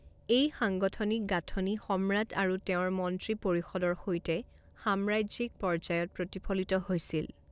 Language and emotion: Assamese, neutral